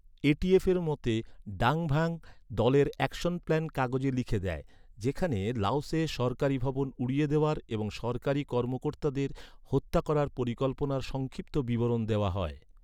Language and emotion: Bengali, neutral